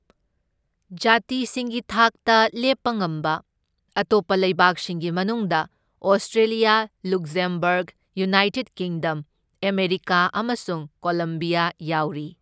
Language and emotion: Manipuri, neutral